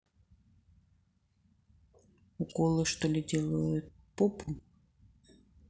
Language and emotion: Russian, neutral